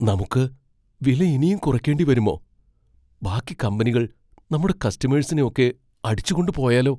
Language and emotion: Malayalam, fearful